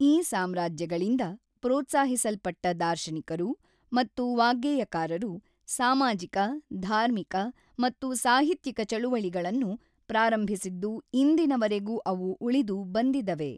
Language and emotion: Kannada, neutral